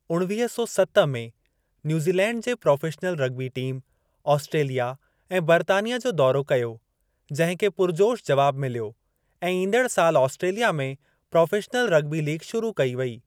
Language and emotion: Sindhi, neutral